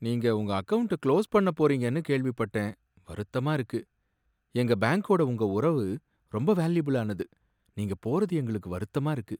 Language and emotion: Tamil, sad